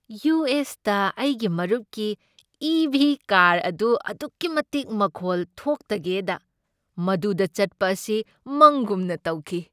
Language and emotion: Manipuri, happy